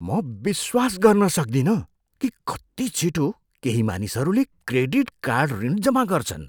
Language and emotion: Nepali, surprised